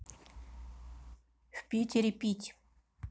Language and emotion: Russian, neutral